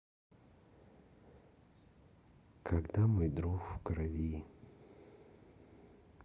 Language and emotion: Russian, neutral